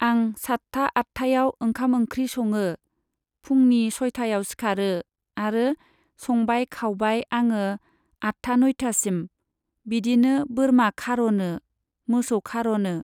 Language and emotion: Bodo, neutral